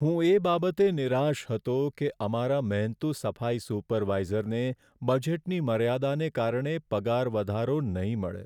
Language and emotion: Gujarati, sad